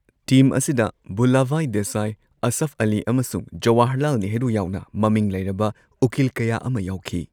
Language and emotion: Manipuri, neutral